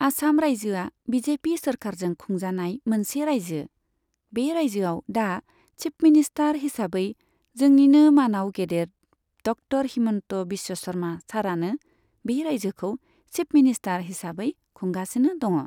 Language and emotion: Bodo, neutral